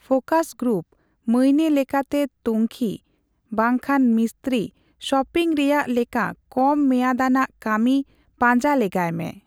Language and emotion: Santali, neutral